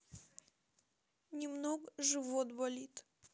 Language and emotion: Russian, sad